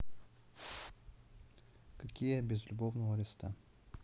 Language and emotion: Russian, sad